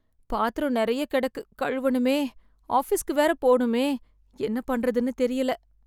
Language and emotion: Tamil, sad